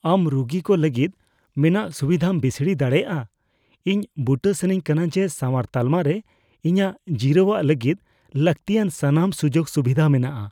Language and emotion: Santali, fearful